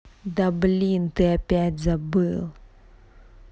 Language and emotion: Russian, angry